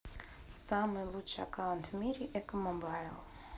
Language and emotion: Russian, neutral